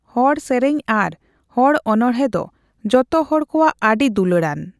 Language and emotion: Santali, neutral